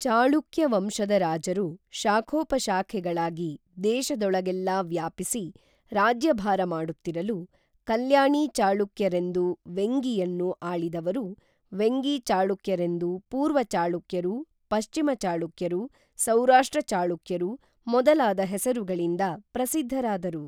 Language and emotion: Kannada, neutral